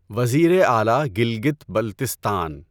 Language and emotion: Urdu, neutral